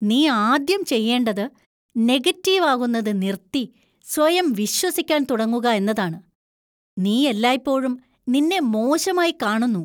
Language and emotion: Malayalam, disgusted